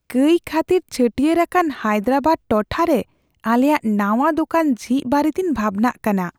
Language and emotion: Santali, fearful